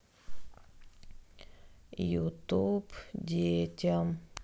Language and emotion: Russian, sad